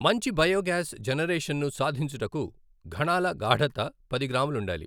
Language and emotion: Telugu, neutral